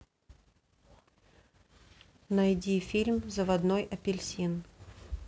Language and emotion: Russian, neutral